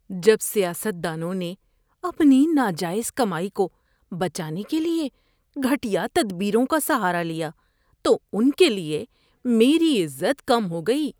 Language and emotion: Urdu, disgusted